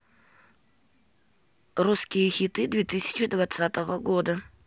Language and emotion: Russian, neutral